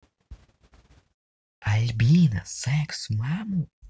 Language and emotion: Russian, positive